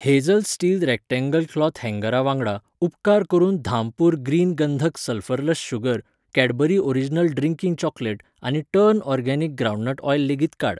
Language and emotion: Goan Konkani, neutral